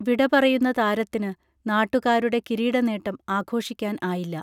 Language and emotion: Malayalam, neutral